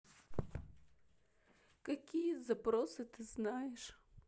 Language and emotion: Russian, sad